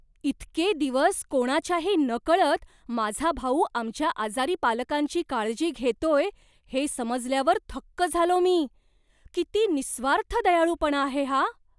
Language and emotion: Marathi, surprised